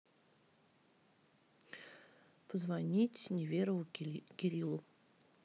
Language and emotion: Russian, neutral